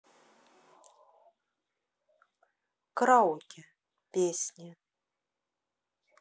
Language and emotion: Russian, neutral